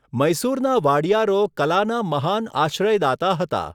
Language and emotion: Gujarati, neutral